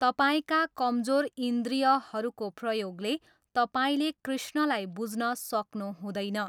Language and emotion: Nepali, neutral